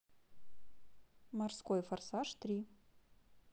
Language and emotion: Russian, neutral